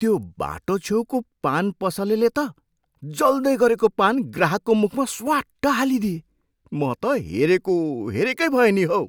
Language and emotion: Nepali, surprised